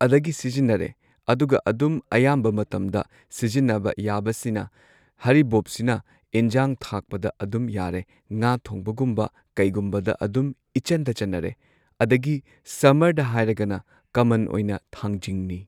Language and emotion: Manipuri, neutral